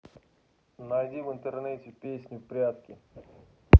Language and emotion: Russian, neutral